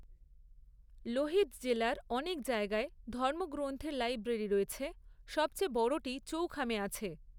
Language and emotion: Bengali, neutral